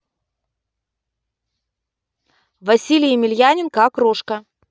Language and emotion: Russian, neutral